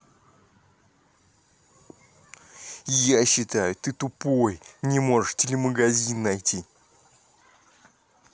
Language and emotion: Russian, angry